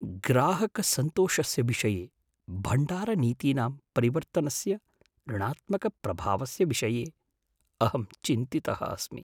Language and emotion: Sanskrit, fearful